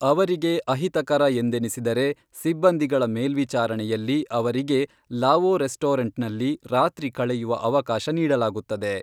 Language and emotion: Kannada, neutral